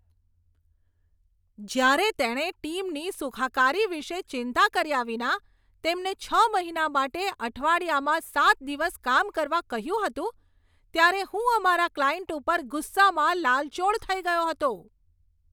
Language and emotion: Gujarati, angry